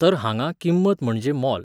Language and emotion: Goan Konkani, neutral